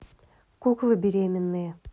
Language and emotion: Russian, neutral